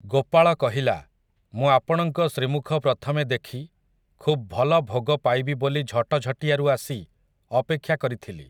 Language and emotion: Odia, neutral